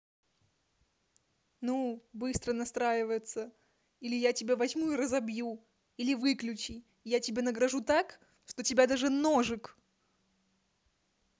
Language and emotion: Russian, angry